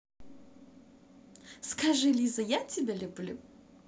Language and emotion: Russian, positive